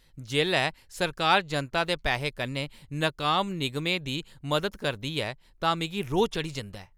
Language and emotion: Dogri, angry